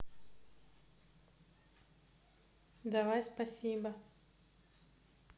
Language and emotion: Russian, neutral